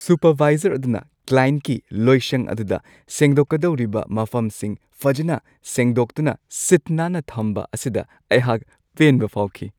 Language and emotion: Manipuri, happy